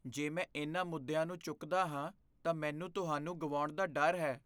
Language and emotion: Punjabi, fearful